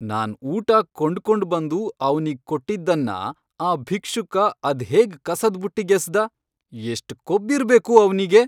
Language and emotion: Kannada, angry